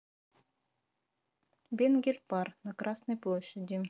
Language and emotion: Russian, neutral